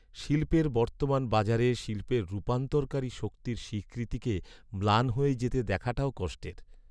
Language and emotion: Bengali, sad